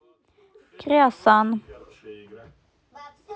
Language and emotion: Russian, neutral